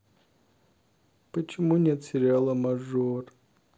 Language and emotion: Russian, sad